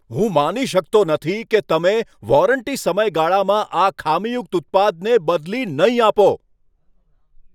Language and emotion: Gujarati, angry